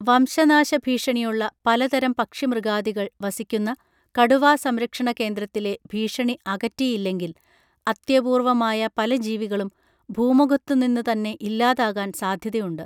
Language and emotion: Malayalam, neutral